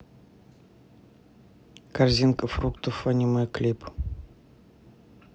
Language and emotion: Russian, neutral